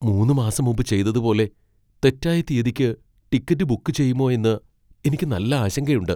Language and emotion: Malayalam, fearful